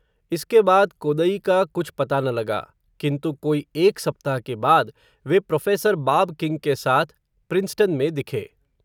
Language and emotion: Hindi, neutral